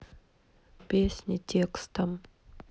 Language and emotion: Russian, neutral